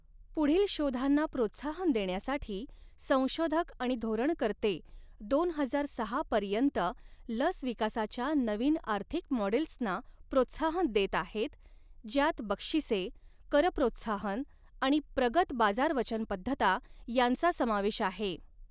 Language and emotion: Marathi, neutral